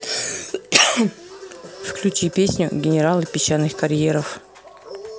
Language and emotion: Russian, neutral